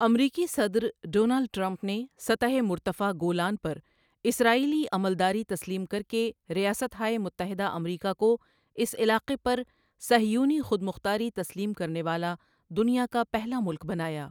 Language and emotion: Urdu, neutral